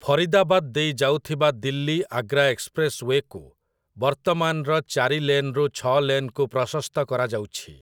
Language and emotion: Odia, neutral